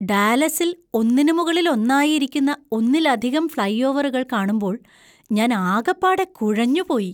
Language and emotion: Malayalam, surprised